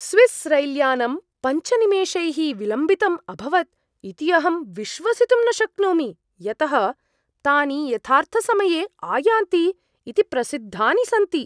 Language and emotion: Sanskrit, surprised